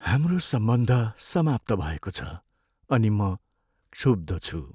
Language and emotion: Nepali, sad